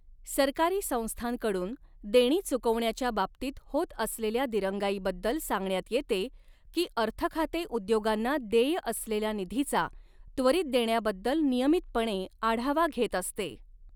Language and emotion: Marathi, neutral